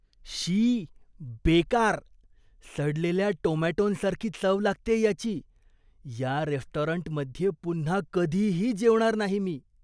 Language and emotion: Marathi, disgusted